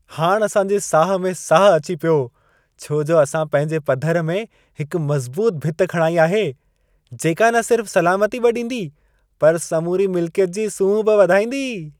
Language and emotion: Sindhi, happy